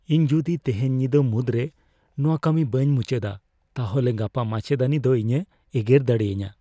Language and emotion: Santali, fearful